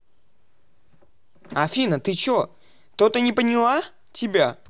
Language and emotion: Russian, angry